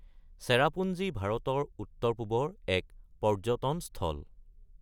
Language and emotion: Assamese, neutral